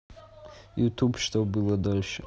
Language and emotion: Russian, neutral